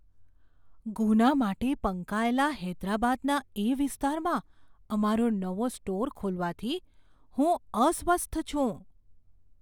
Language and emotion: Gujarati, fearful